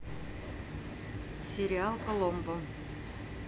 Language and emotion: Russian, neutral